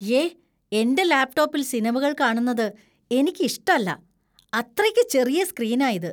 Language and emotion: Malayalam, disgusted